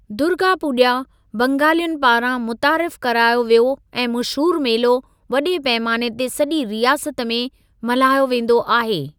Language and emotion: Sindhi, neutral